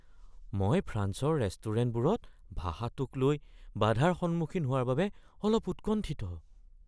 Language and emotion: Assamese, fearful